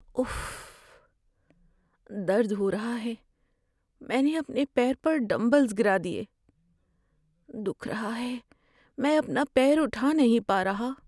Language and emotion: Urdu, sad